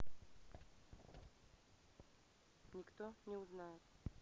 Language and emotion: Russian, neutral